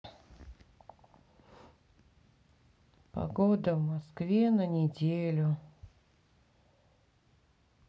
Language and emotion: Russian, sad